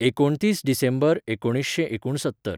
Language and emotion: Goan Konkani, neutral